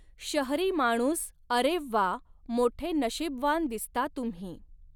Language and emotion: Marathi, neutral